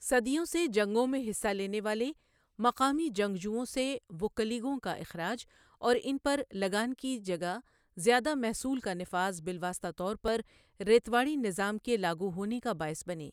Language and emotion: Urdu, neutral